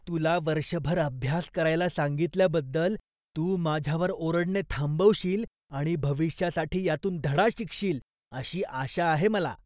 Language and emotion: Marathi, disgusted